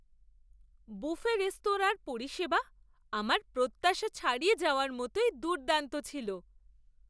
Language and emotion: Bengali, surprised